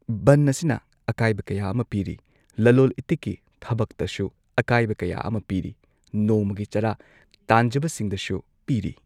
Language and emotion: Manipuri, neutral